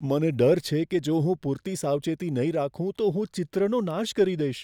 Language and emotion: Gujarati, fearful